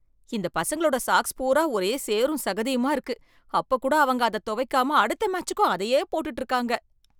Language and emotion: Tamil, disgusted